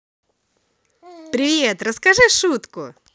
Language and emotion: Russian, positive